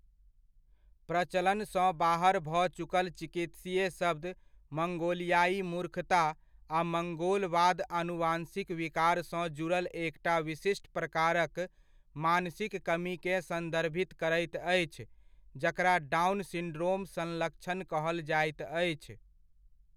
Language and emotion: Maithili, neutral